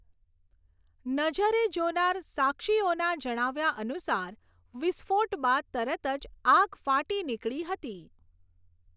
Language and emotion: Gujarati, neutral